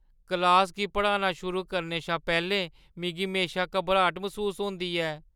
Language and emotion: Dogri, fearful